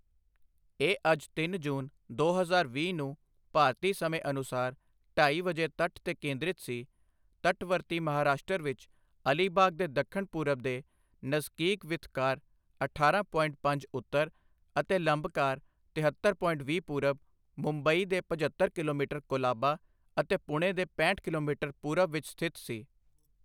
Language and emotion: Punjabi, neutral